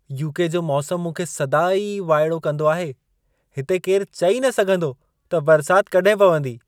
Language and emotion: Sindhi, surprised